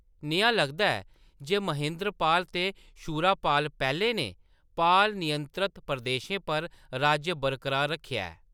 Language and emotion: Dogri, neutral